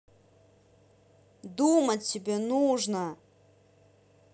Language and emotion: Russian, angry